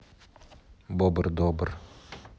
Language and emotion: Russian, neutral